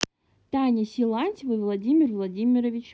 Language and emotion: Russian, neutral